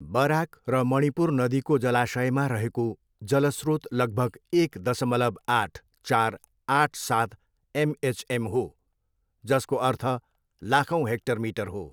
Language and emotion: Nepali, neutral